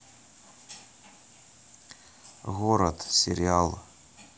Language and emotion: Russian, neutral